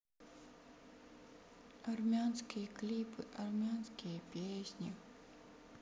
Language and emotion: Russian, sad